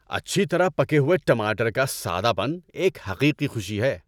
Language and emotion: Urdu, happy